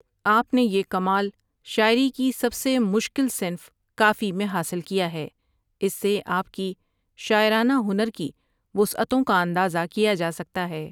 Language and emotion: Urdu, neutral